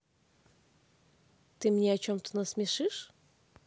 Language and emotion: Russian, positive